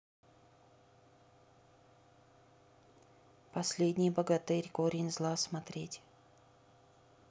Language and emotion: Russian, neutral